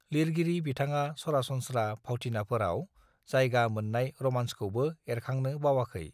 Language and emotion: Bodo, neutral